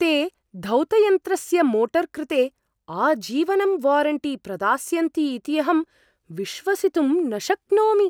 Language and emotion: Sanskrit, surprised